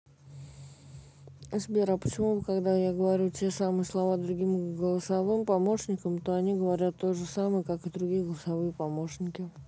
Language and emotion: Russian, neutral